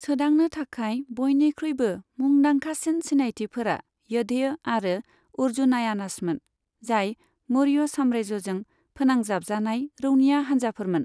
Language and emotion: Bodo, neutral